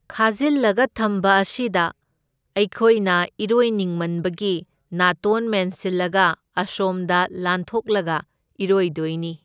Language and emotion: Manipuri, neutral